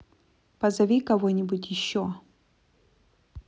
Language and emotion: Russian, neutral